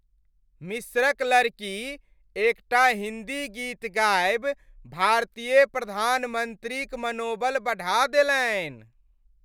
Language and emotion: Maithili, happy